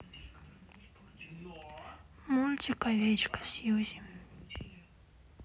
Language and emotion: Russian, sad